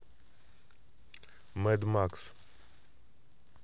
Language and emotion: Russian, neutral